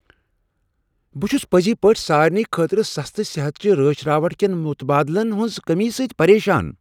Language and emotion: Kashmiri, angry